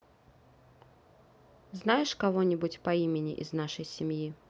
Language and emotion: Russian, neutral